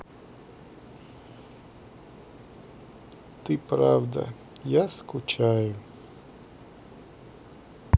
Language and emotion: Russian, sad